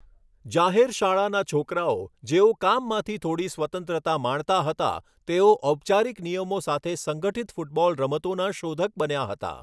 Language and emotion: Gujarati, neutral